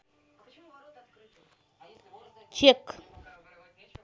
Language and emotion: Russian, neutral